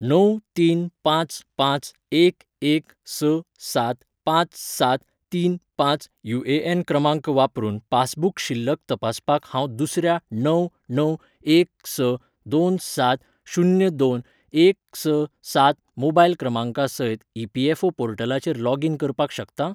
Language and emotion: Goan Konkani, neutral